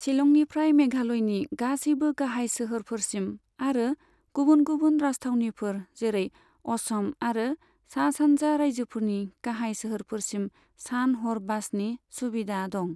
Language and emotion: Bodo, neutral